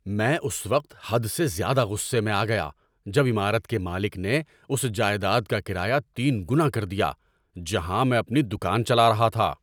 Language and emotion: Urdu, angry